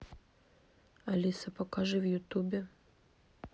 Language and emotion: Russian, neutral